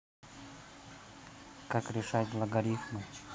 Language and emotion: Russian, neutral